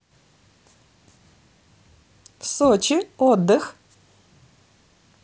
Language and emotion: Russian, positive